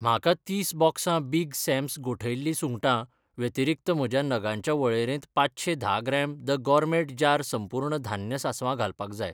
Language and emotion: Goan Konkani, neutral